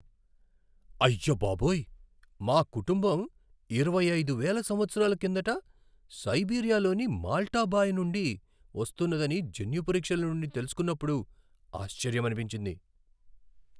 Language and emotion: Telugu, surprised